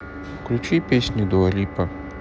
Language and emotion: Russian, neutral